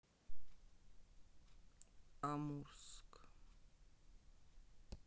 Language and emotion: Russian, neutral